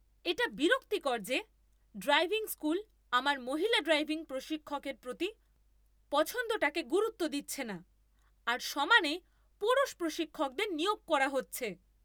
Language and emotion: Bengali, angry